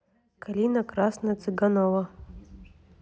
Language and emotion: Russian, neutral